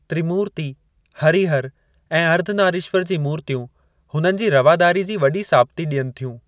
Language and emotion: Sindhi, neutral